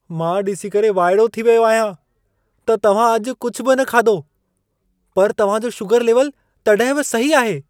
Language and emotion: Sindhi, surprised